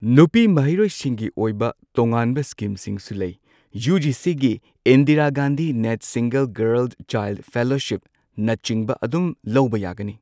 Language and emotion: Manipuri, neutral